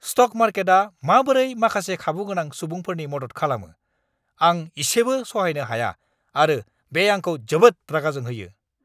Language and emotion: Bodo, angry